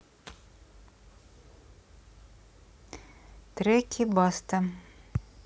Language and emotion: Russian, neutral